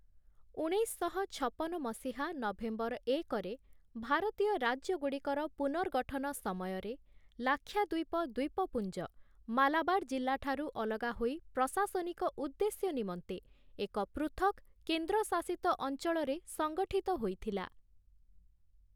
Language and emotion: Odia, neutral